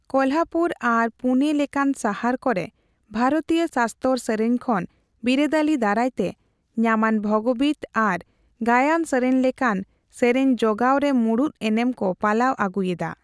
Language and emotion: Santali, neutral